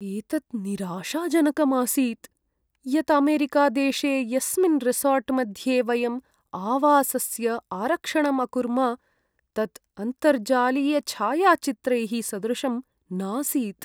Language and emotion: Sanskrit, sad